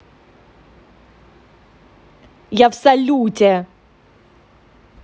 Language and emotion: Russian, angry